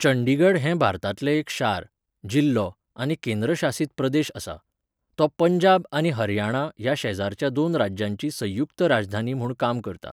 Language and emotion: Goan Konkani, neutral